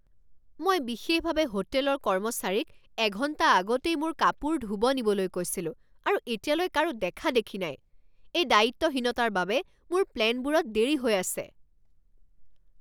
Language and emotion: Assamese, angry